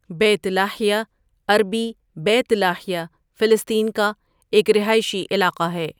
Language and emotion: Urdu, neutral